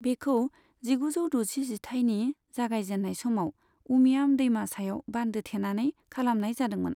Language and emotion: Bodo, neutral